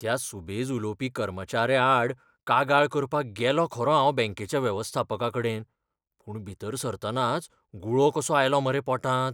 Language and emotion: Goan Konkani, fearful